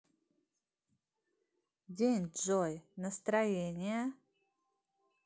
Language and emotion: Russian, positive